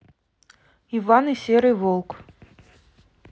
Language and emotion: Russian, neutral